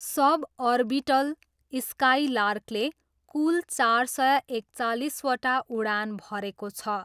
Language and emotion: Nepali, neutral